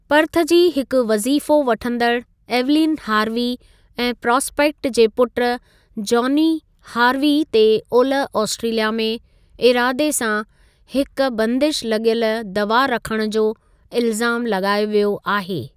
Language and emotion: Sindhi, neutral